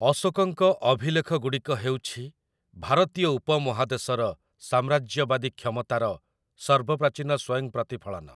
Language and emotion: Odia, neutral